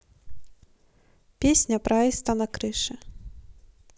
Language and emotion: Russian, neutral